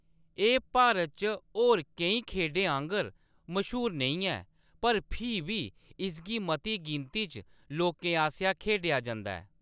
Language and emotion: Dogri, neutral